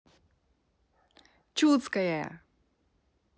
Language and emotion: Russian, positive